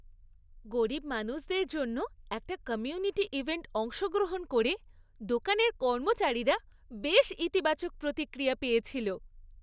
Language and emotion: Bengali, happy